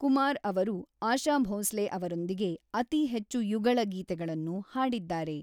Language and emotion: Kannada, neutral